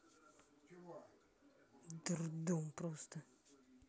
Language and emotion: Russian, angry